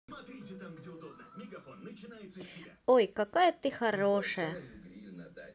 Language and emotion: Russian, positive